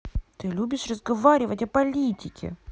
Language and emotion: Russian, angry